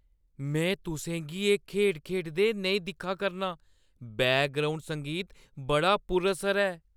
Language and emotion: Dogri, fearful